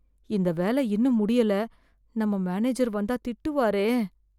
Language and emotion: Tamil, fearful